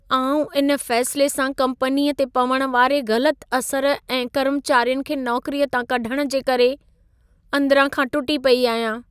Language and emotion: Sindhi, sad